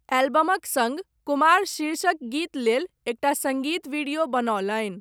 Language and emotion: Maithili, neutral